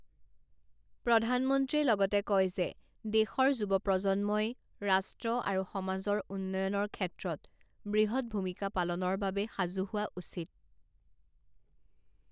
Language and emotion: Assamese, neutral